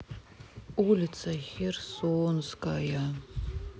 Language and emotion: Russian, sad